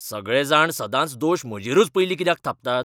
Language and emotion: Goan Konkani, angry